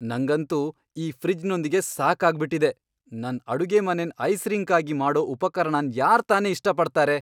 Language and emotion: Kannada, angry